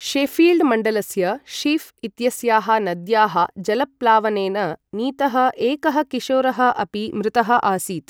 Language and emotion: Sanskrit, neutral